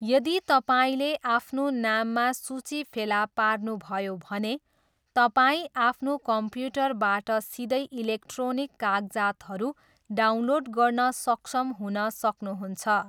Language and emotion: Nepali, neutral